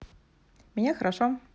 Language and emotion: Russian, neutral